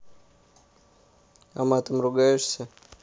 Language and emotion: Russian, neutral